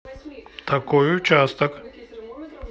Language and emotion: Russian, neutral